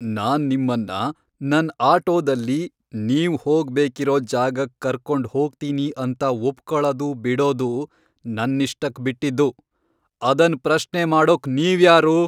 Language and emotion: Kannada, angry